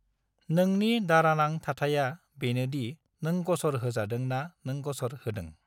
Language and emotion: Bodo, neutral